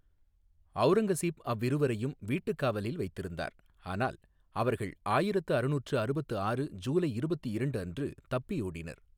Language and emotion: Tamil, neutral